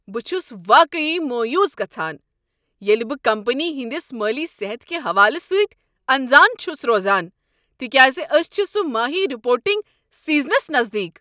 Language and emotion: Kashmiri, angry